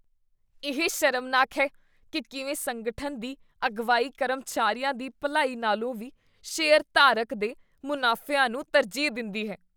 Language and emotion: Punjabi, disgusted